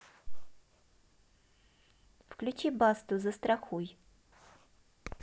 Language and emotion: Russian, neutral